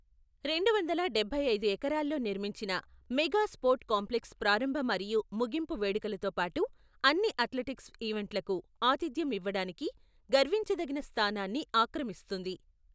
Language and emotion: Telugu, neutral